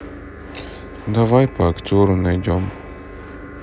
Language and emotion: Russian, sad